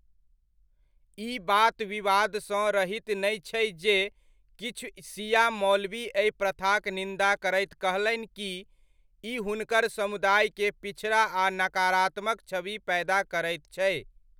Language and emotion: Maithili, neutral